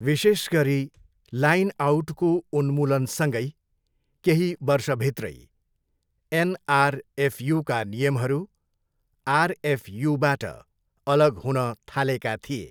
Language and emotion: Nepali, neutral